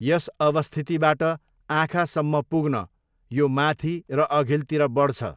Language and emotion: Nepali, neutral